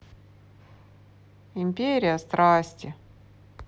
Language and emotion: Russian, sad